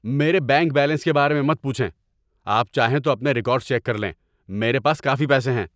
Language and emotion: Urdu, angry